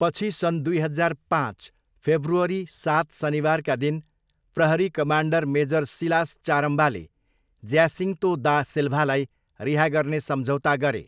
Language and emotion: Nepali, neutral